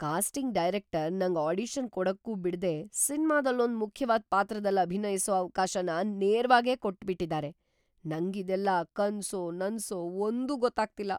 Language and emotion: Kannada, surprised